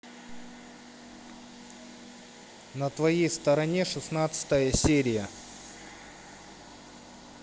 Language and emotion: Russian, neutral